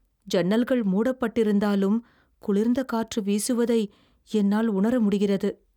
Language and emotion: Tamil, fearful